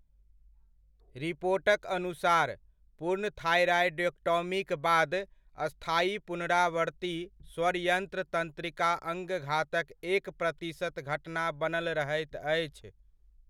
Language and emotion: Maithili, neutral